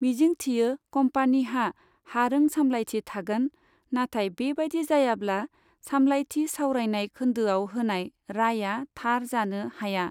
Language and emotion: Bodo, neutral